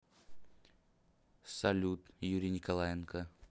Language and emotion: Russian, neutral